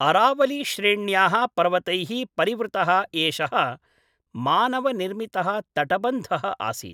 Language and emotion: Sanskrit, neutral